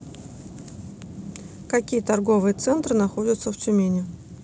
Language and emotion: Russian, neutral